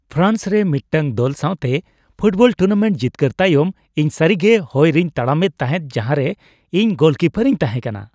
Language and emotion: Santali, happy